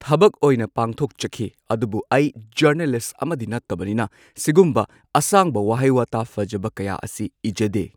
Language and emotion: Manipuri, neutral